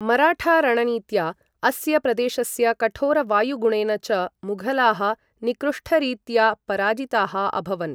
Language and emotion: Sanskrit, neutral